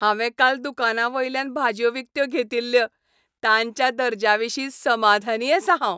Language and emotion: Goan Konkani, happy